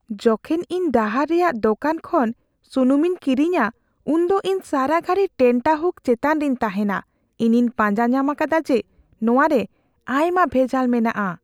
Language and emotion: Santali, fearful